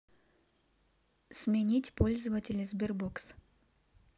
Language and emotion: Russian, neutral